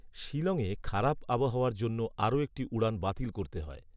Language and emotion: Bengali, neutral